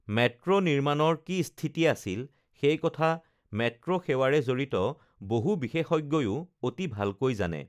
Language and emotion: Assamese, neutral